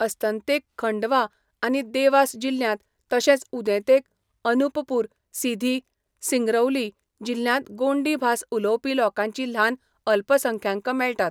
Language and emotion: Goan Konkani, neutral